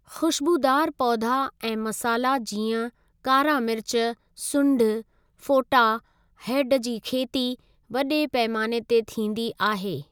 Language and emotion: Sindhi, neutral